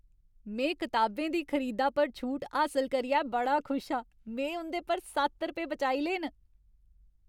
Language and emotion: Dogri, happy